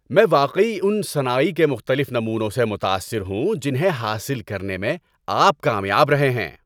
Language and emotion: Urdu, happy